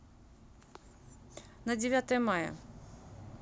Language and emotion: Russian, neutral